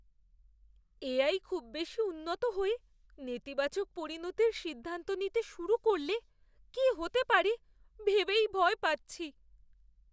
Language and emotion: Bengali, fearful